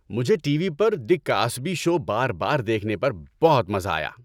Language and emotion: Urdu, happy